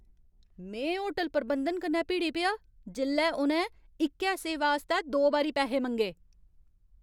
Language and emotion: Dogri, angry